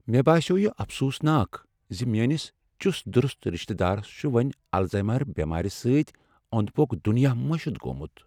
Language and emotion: Kashmiri, sad